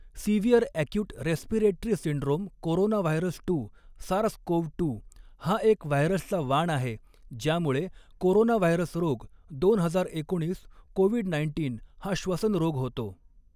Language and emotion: Marathi, neutral